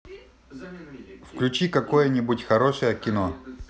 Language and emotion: Russian, positive